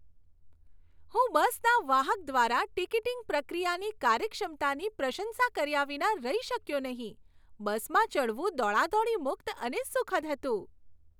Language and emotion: Gujarati, happy